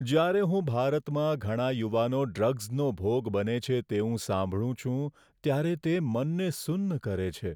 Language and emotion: Gujarati, sad